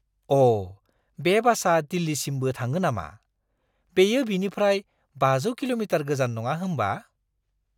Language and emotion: Bodo, surprised